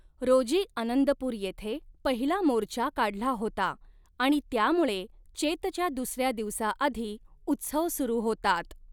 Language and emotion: Marathi, neutral